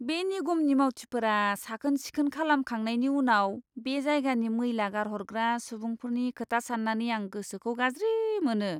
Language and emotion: Bodo, disgusted